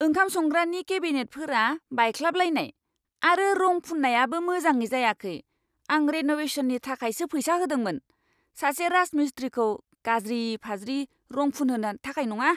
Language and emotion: Bodo, angry